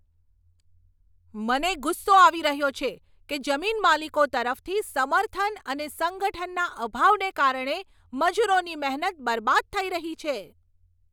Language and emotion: Gujarati, angry